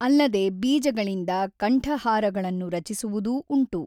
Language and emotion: Kannada, neutral